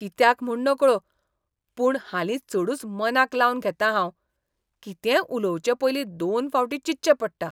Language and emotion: Goan Konkani, disgusted